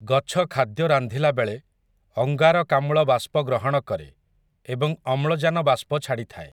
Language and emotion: Odia, neutral